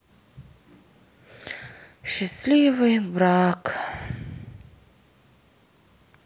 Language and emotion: Russian, sad